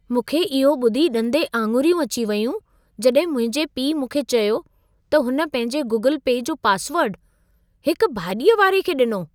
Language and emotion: Sindhi, surprised